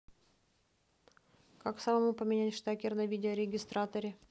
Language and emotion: Russian, neutral